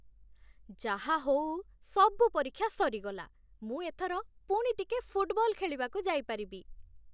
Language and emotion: Odia, happy